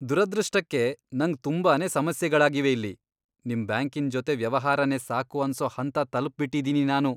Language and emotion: Kannada, disgusted